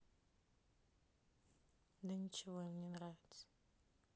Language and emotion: Russian, sad